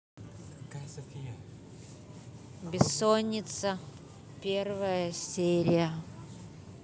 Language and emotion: Russian, neutral